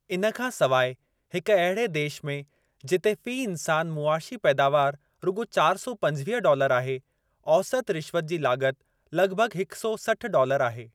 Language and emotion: Sindhi, neutral